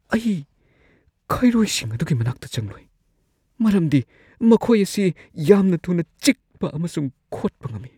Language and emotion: Manipuri, fearful